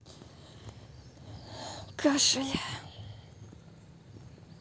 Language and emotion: Russian, sad